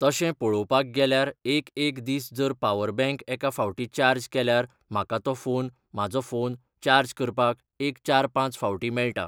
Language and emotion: Goan Konkani, neutral